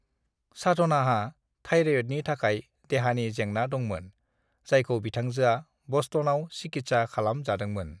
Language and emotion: Bodo, neutral